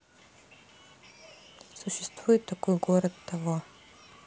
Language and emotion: Russian, neutral